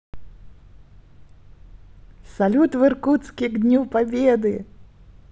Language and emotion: Russian, positive